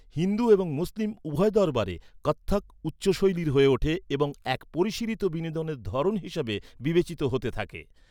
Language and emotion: Bengali, neutral